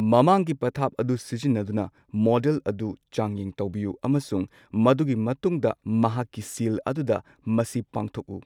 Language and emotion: Manipuri, neutral